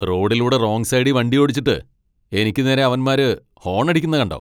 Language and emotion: Malayalam, angry